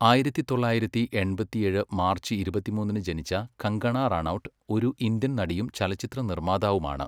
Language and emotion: Malayalam, neutral